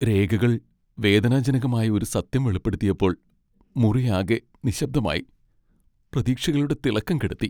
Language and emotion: Malayalam, sad